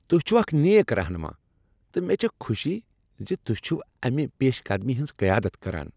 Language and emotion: Kashmiri, happy